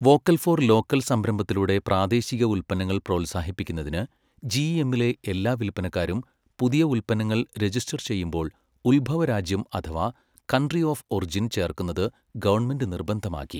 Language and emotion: Malayalam, neutral